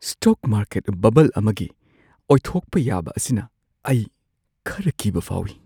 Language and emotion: Manipuri, fearful